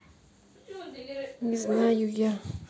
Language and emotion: Russian, angry